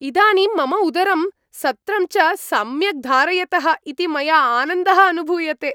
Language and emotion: Sanskrit, happy